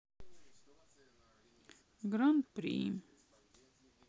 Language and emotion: Russian, sad